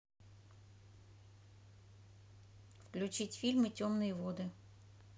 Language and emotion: Russian, neutral